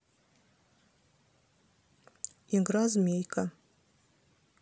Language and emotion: Russian, neutral